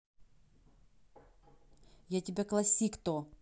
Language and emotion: Russian, angry